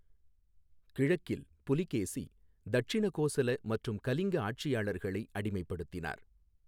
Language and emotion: Tamil, neutral